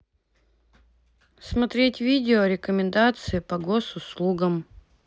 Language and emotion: Russian, neutral